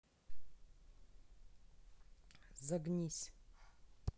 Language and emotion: Russian, neutral